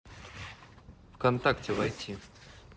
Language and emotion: Russian, neutral